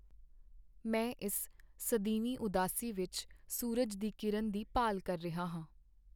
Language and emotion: Punjabi, sad